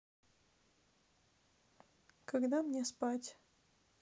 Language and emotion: Russian, neutral